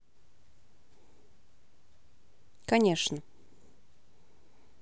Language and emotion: Russian, neutral